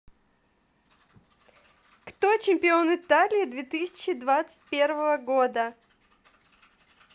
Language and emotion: Russian, positive